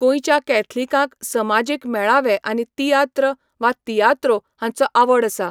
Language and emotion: Goan Konkani, neutral